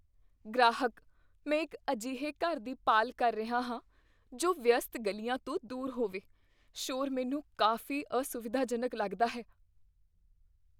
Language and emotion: Punjabi, fearful